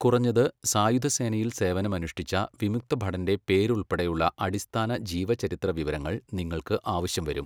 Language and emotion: Malayalam, neutral